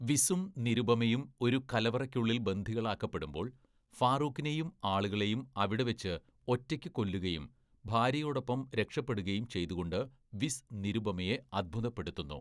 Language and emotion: Malayalam, neutral